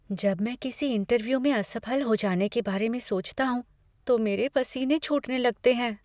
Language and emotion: Hindi, fearful